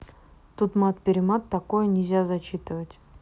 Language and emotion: Russian, neutral